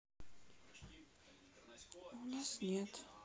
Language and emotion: Russian, sad